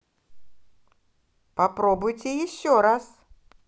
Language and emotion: Russian, positive